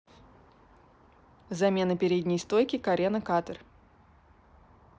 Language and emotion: Russian, neutral